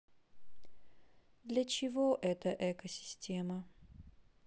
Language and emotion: Russian, sad